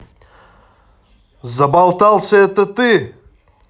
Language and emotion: Russian, angry